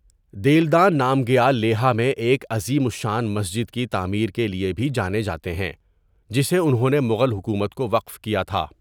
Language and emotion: Urdu, neutral